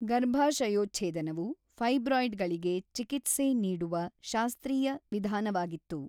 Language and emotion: Kannada, neutral